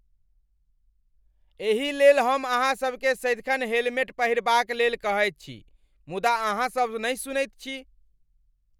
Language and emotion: Maithili, angry